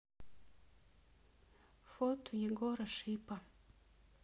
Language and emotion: Russian, sad